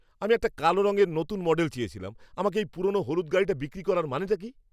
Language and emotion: Bengali, angry